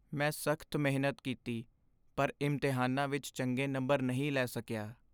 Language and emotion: Punjabi, sad